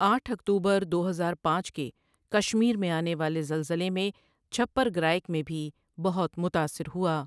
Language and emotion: Urdu, neutral